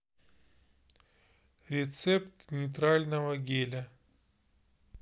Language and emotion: Russian, neutral